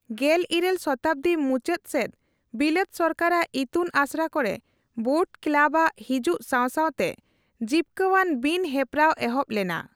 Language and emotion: Santali, neutral